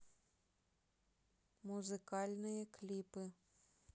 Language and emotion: Russian, neutral